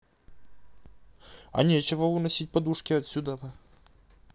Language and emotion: Russian, neutral